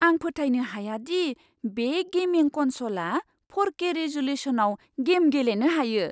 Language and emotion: Bodo, surprised